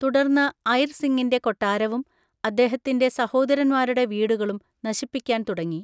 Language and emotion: Malayalam, neutral